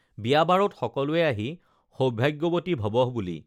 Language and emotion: Assamese, neutral